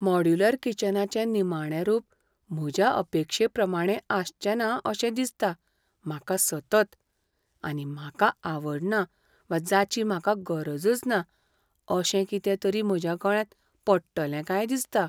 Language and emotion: Goan Konkani, fearful